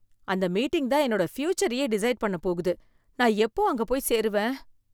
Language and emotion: Tamil, fearful